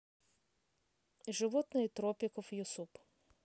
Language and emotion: Russian, neutral